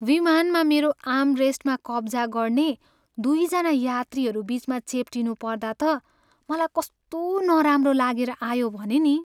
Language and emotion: Nepali, sad